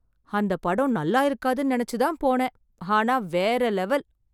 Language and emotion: Tamil, surprised